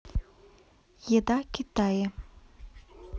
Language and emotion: Russian, neutral